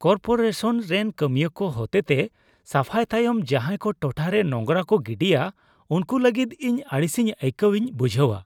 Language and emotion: Santali, disgusted